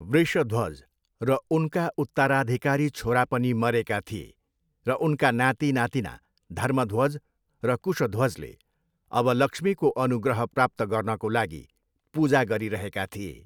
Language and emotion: Nepali, neutral